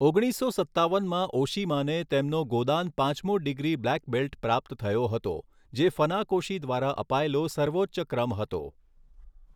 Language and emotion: Gujarati, neutral